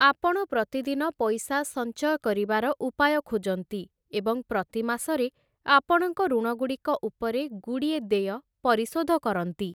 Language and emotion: Odia, neutral